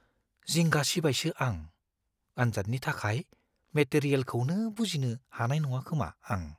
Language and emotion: Bodo, fearful